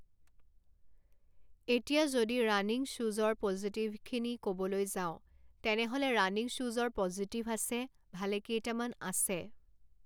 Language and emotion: Assamese, neutral